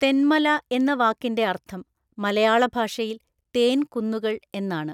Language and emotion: Malayalam, neutral